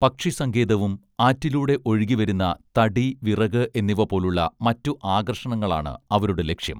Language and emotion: Malayalam, neutral